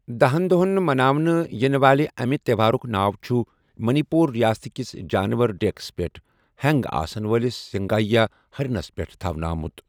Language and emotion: Kashmiri, neutral